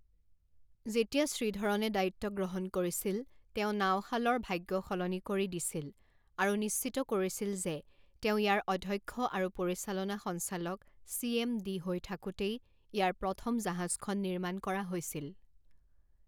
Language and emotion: Assamese, neutral